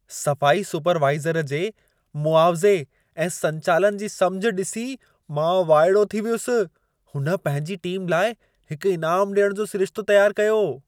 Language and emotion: Sindhi, surprised